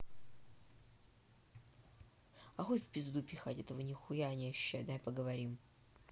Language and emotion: Russian, angry